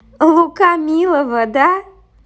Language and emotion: Russian, positive